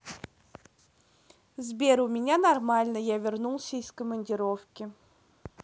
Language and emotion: Russian, neutral